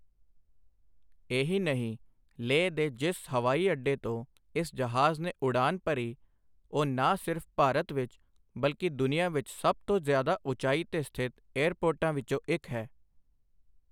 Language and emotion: Punjabi, neutral